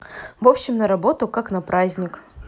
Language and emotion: Russian, neutral